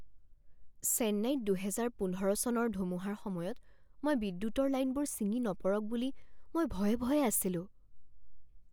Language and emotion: Assamese, fearful